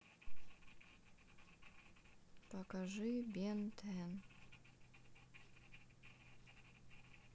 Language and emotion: Russian, sad